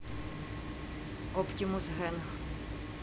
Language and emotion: Russian, neutral